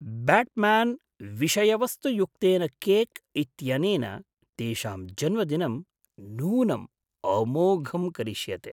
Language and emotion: Sanskrit, surprised